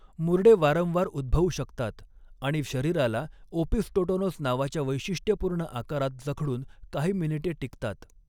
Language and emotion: Marathi, neutral